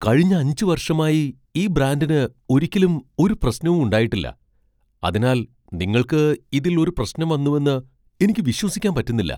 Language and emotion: Malayalam, surprised